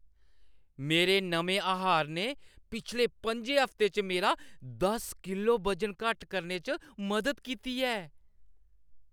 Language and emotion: Dogri, happy